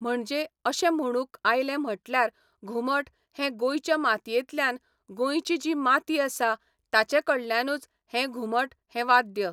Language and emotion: Goan Konkani, neutral